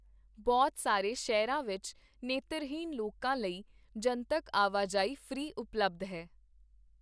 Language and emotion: Punjabi, neutral